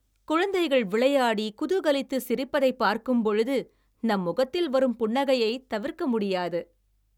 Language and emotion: Tamil, happy